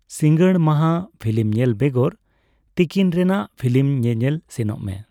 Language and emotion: Santali, neutral